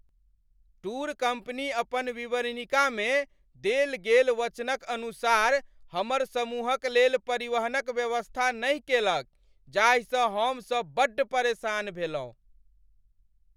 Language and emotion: Maithili, angry